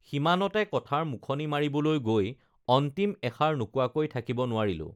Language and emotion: Assamese, neutral